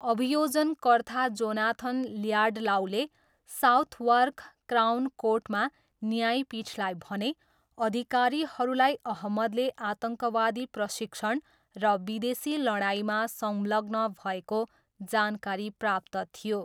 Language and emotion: Nepali, neutral